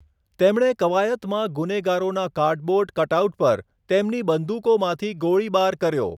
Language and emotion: Gujarati, neutral